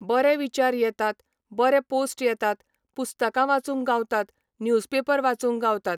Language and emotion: Goan Konkani, neutral